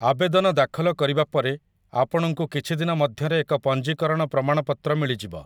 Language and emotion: Odia, neutral